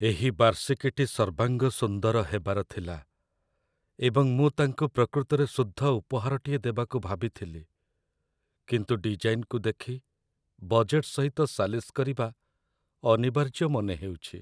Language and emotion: Odia, sad